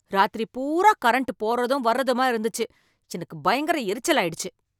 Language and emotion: Tamil, angry